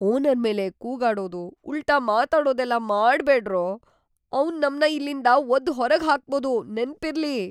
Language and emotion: Kannada, fearful